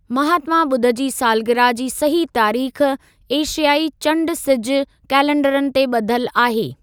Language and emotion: Sindhi, neutral